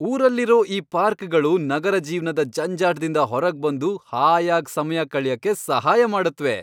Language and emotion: Kannada, happy